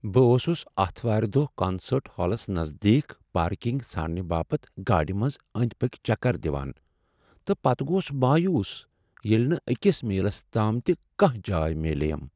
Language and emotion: Kashmiri, sad